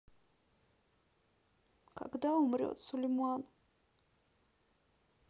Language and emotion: Russian, sad